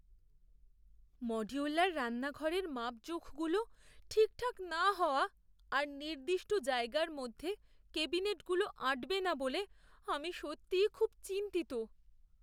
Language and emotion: Bengali, fearful